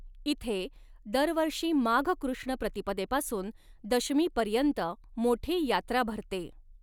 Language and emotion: Marathi, neutral